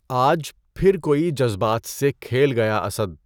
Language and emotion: Urdu, neutral